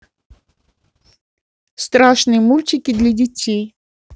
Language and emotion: Russian, neutral